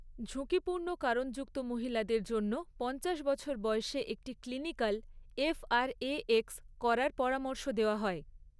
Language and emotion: Bengali, neutral